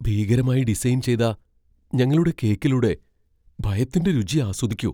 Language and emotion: Malayalam, fearful